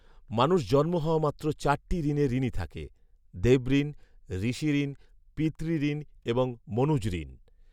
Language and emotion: Bengali, neutral